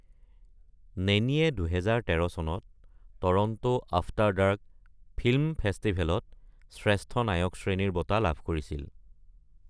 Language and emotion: Assamese, neutral